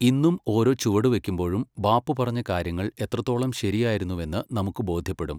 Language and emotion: Malayalam, neutral